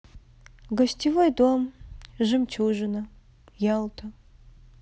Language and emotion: Russian, sad